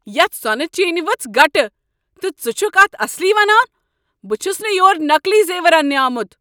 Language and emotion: Kashmiri, angry